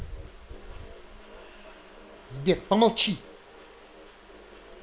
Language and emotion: Russian, angry